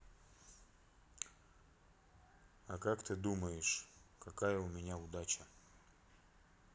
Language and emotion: Russian, neutral